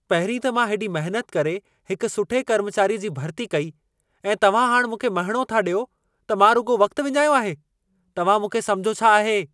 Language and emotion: Sindhi, angry